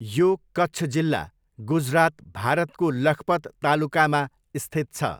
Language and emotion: Nepali, neutral